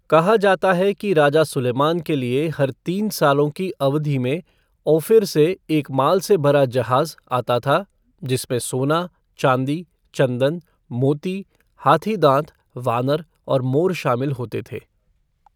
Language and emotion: Hindi, neutral